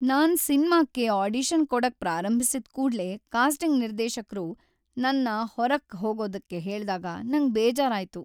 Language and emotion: Kannada, sad